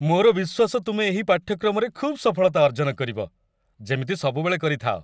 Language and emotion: Odia, happy